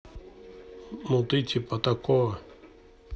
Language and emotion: Russian, neutral